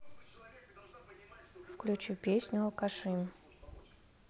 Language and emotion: Russian, neutral